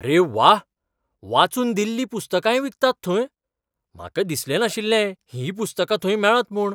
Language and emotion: Goan Konkani, surprised